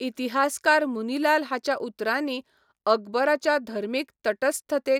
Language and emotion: Goan Konkani, neutral